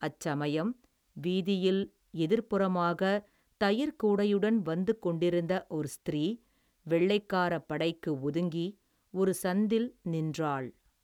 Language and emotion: Tamil, neutral